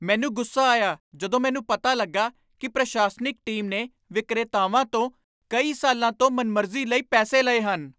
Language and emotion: Punjabi, angry